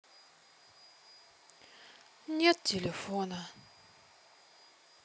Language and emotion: Russian, sad